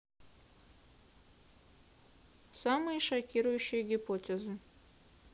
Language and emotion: Russian, neutral